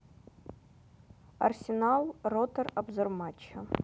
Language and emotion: Russian, neutral